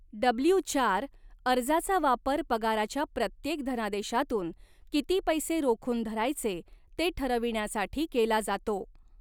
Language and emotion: Marathi, neutral